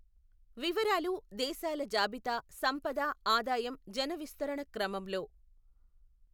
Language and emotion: Telugu, neutral